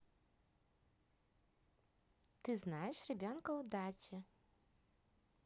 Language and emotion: Russian, positive